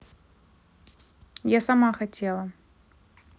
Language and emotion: Russian, neutral